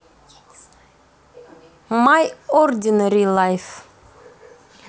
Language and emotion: Russian, neutral